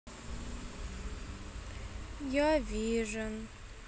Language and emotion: Russian, sad